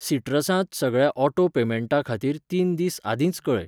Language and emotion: Goan Konkani, neutral